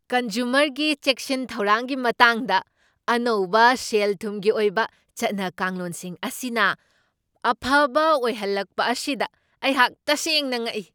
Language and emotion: Manipuri, surprised